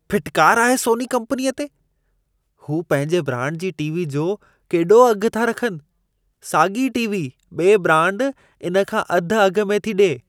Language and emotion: Sindhi, disgusted